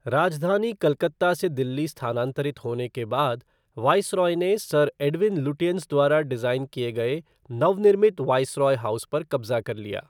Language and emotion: Hindi, neutral